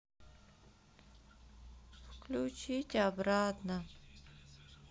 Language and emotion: Russian, sad